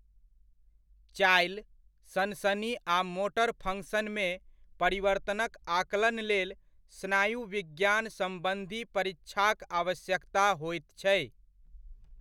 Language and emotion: Maithili, neutral